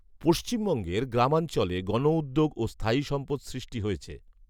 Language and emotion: Bengali, neutral